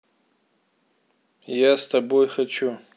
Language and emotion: Russian, neutral